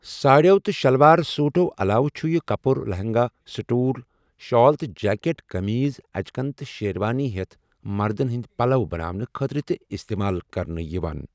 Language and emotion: Kashmiri, neutral